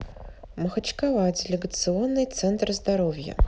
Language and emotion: Russian, neutral